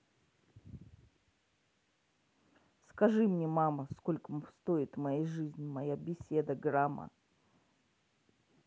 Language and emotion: Russian, neutral